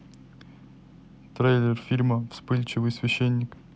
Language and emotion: Russian, neutral